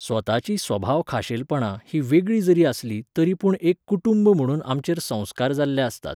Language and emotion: Goan Konkani, neutral